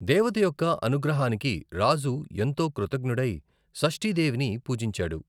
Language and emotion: Telugu, neutral